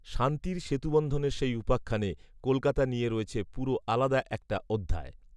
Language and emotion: Bengali, neutral